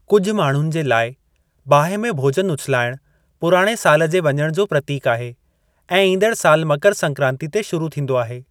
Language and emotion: Sindhi, neutral